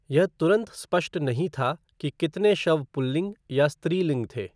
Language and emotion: Hindi, neutral